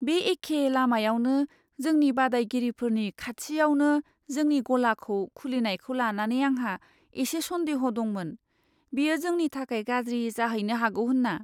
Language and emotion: Bodo, fearful